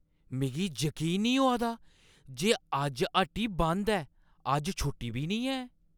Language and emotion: Dogri, surprised